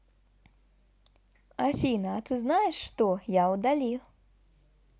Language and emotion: Russian, positive